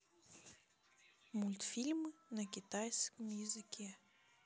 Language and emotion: Russian, neutral